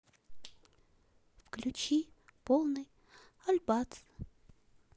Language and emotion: Russian, sad